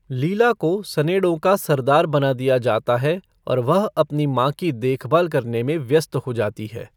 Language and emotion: Hindi, neutral